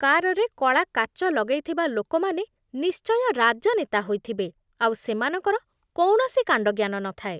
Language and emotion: Odia, disgusted